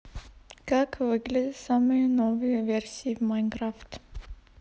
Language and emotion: Russian, neutral